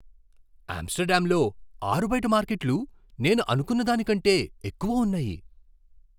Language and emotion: Telugu, surprised